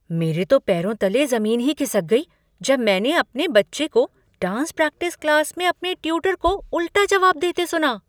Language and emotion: Hindi, surprised